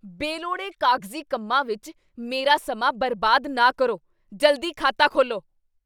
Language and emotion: Punjabi, angry